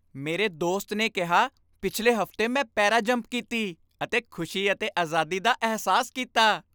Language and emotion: Punjabi, happy